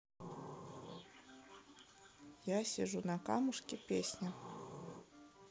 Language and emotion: Russian, neutral